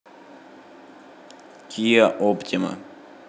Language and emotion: Russian, neutral